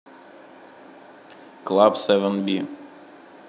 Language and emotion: Russian, neutral